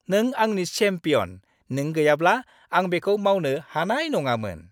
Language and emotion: Bodo, happy